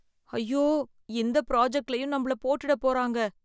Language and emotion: Tamil, fearful